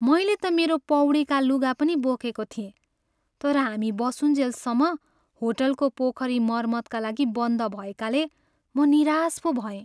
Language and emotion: Nepali, sad